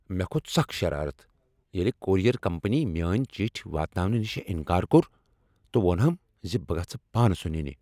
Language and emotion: Kashmiri, angry